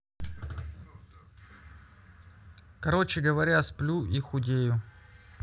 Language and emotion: Russian, neutral